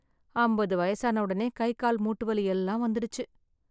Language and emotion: Tamil, sad